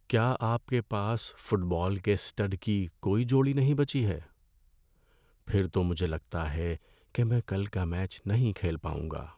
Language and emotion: Urdu, sad